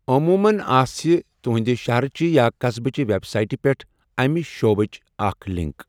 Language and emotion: Kashmiri, neutral